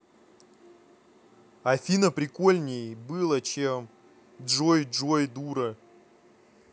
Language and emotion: Russian, angry